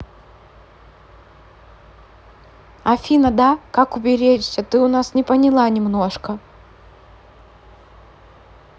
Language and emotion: Russian, neutral